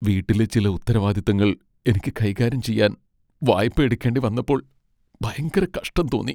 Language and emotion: Malayalam, sad